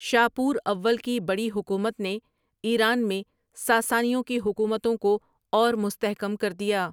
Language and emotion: Urdu, neutral